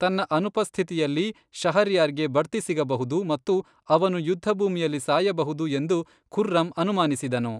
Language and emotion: Kannada, neutral